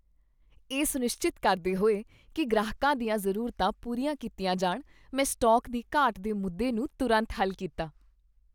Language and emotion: Punjabi, happy